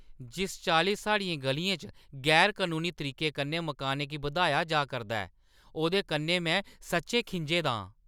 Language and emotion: Dogri, angry